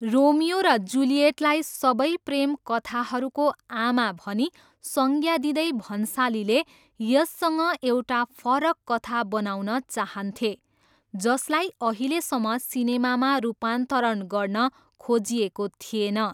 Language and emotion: Nepali, neutral